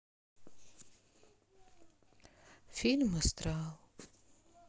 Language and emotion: Russian, sad